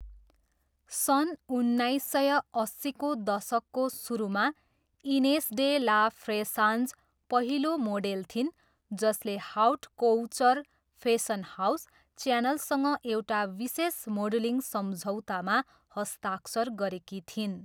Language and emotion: Nepali, neutral